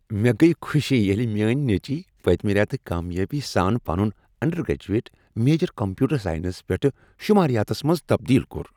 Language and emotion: Kashmiri, happy